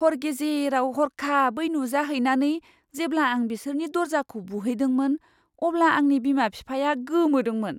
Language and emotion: Bodo, surprised